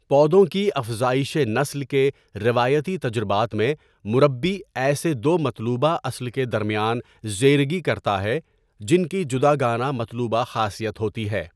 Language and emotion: Urdu, neutral